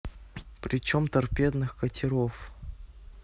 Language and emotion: Russian, neutral